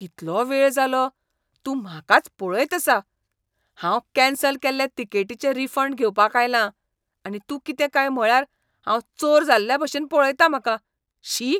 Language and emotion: Goan Konkani, disgusted